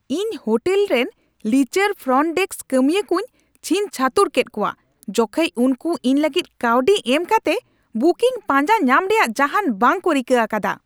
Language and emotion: Santali, angry